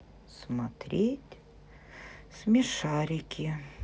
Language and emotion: Russian, sad